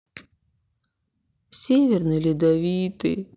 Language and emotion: Russian, sad